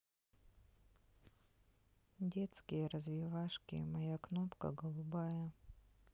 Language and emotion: Russian, sad